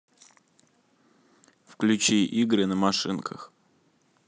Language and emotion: Russian, neutral